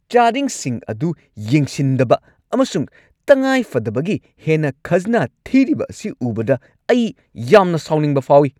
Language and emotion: Manipuri, angry